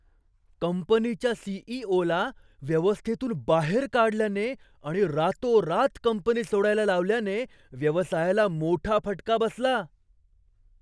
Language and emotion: Marathi, surprised